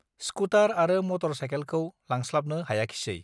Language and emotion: Bodo, neutral